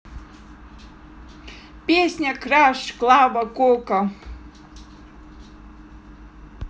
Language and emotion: Russian, positive